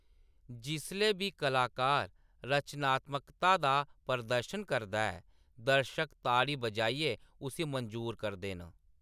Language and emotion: Dogri, neutral